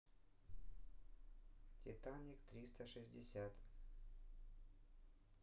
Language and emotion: Russian, neutral